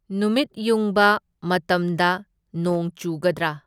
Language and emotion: Manipuri, neutral